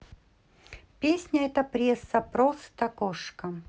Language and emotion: Russian, neutral